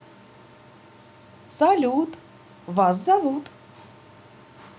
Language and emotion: Russian, positive